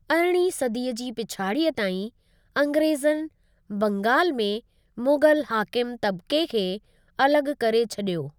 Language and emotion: Sindhi, neutral